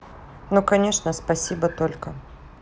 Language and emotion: Russian, neutral